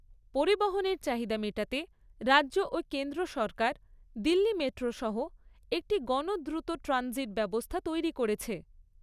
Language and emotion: Bengali, neutral